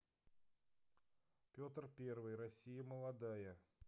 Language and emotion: Russian, neutral